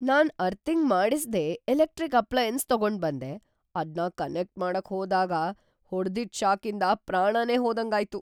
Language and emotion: Kannada, fearful